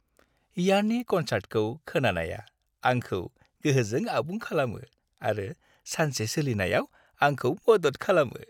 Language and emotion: Bodo, happy